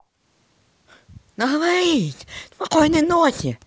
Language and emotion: Russian, positive